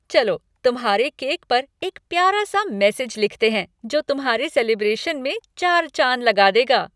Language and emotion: Hindi, happy